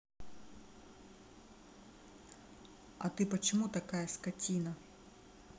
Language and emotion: Russian, angry